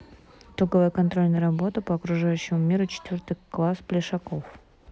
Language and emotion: Russian, neutral